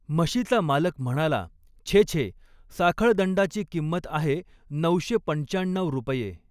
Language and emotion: Marathi, neutral